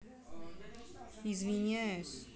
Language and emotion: Russian, neutral